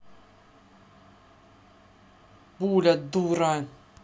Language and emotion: Russian, angry